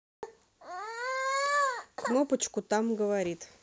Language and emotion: Russian, neutral